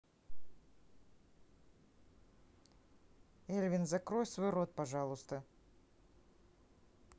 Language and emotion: Russian, angry